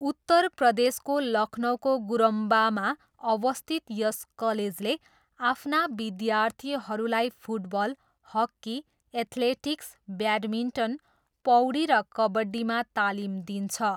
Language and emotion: Nepali, neutral